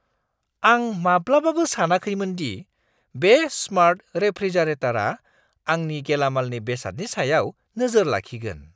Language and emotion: Bodo, surprised